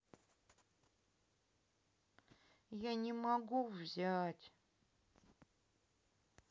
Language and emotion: Russian, sad